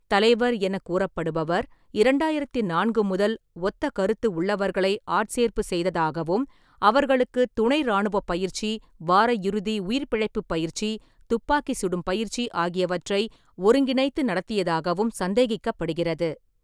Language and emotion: Tamil, neutral